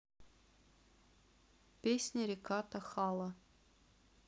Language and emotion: Russian, neutral